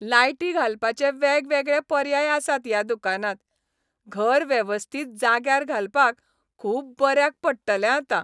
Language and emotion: Goan Konkani, happy